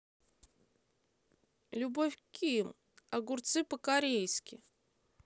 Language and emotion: Russian, neutral